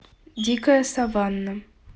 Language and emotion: Russian, neutral